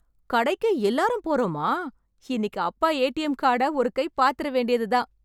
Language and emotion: Tamil, happy